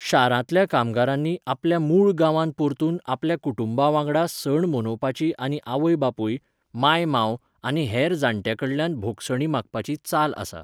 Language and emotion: Goan Konkani, neutral